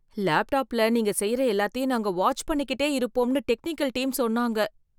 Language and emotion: Tamil, fearful